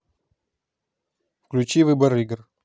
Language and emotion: Russian, neutral